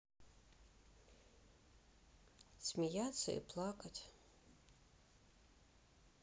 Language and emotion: Russian, sad